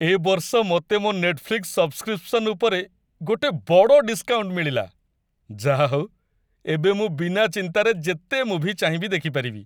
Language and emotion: Odia, happy